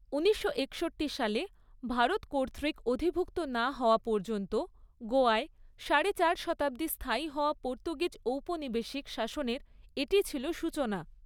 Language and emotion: Bengali, neutral